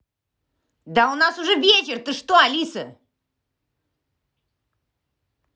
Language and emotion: Russian, angry